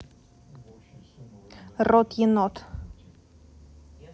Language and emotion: Russian, neutral